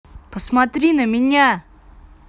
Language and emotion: Russian, angry